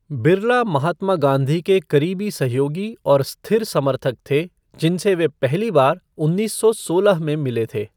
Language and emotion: Hindi, neutral